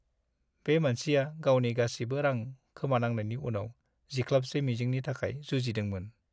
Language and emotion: Bodo, sad